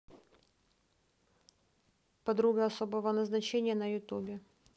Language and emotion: Russian, neutral